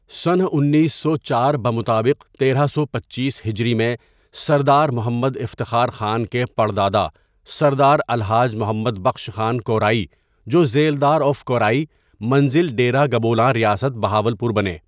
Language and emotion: Urdu, neutral